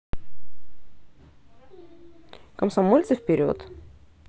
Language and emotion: Russian, positive